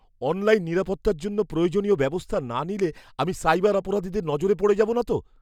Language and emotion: Bengali, fearful